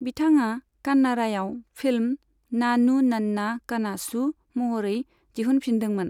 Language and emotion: Bodo, neutral